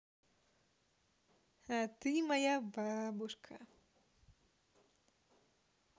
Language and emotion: Russian, positive